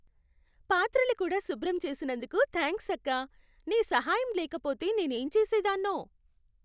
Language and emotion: Telugu, happy